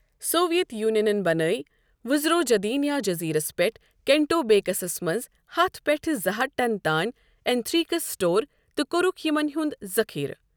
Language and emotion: Kashmiri, neutral